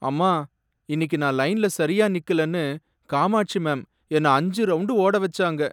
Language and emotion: Tamil, sad